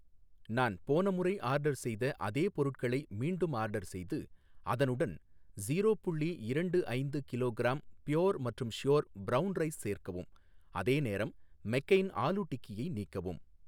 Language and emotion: Tamil, neutral